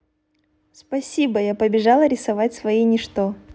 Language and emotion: Russian, positive